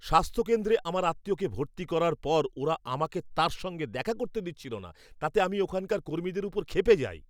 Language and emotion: Bengali, angry